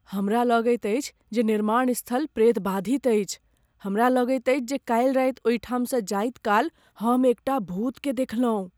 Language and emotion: Maithili, fearful